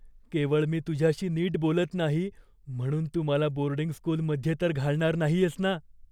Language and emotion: Marathi, fearful